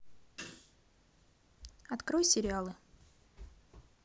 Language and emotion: Russian, neutral